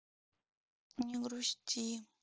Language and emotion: Russian, sad